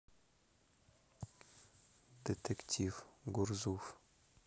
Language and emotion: Russian, neutral